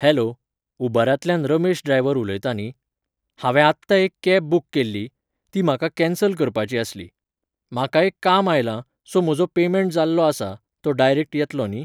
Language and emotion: Goan Konkani, neutral